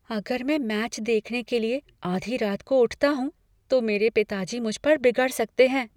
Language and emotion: Hindi, fearful